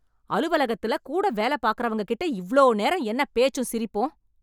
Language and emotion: Tamil, angry